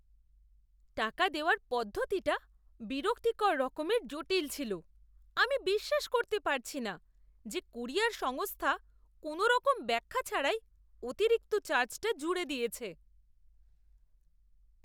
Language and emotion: Bengali, disgusted